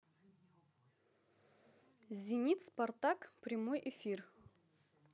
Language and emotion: Russian, positive